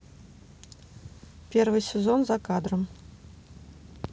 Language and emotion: Russian, neutral